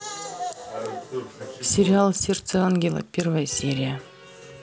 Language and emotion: Russian, neutral